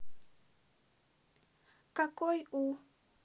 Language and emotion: Russian, neutral